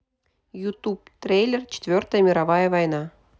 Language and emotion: Russian, neutral